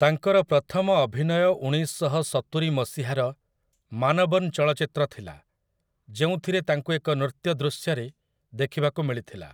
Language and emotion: Odia, neutral